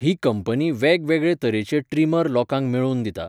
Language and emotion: Goan Konkani, neutral